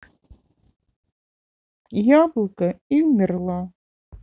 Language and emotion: Russian, sad